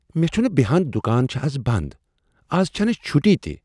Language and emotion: Kashmiri, surprised